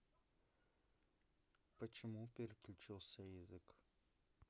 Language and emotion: Russian, neutral